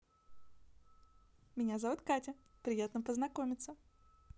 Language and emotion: Russian, positive